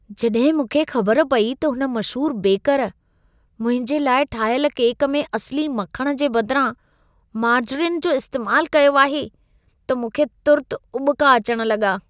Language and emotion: Sindhi, disgusted